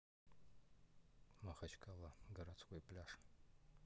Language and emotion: Russian, neutral